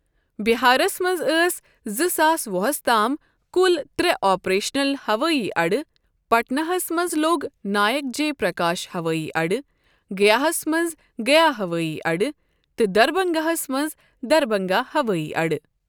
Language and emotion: Kashmiri, neutral